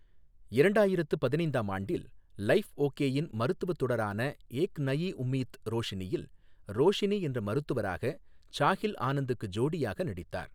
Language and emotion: Tamil, neutral